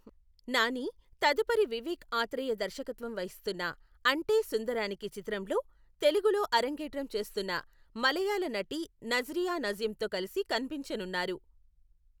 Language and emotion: Telugu, neutral